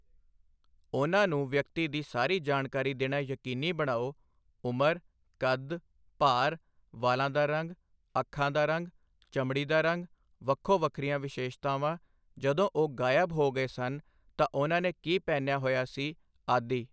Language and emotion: Punjabi, neutral